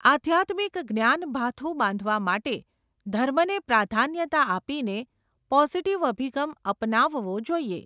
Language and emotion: Gujarati, neutral